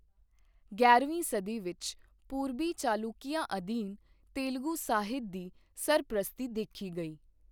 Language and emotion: Punjabi, neutral